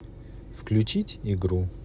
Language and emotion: Russian, neutral